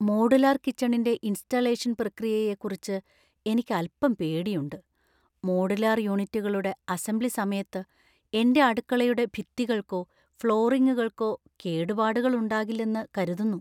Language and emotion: Malayalam, fearful